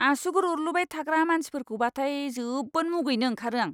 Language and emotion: Bodo, disgusted